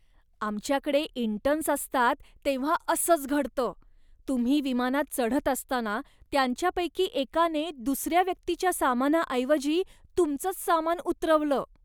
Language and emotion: Marathi, disgusted